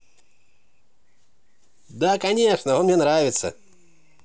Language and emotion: Russian, positive